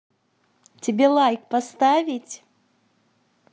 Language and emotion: Russian, positive